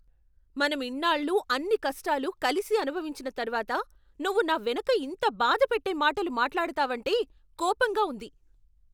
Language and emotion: Telugu, angry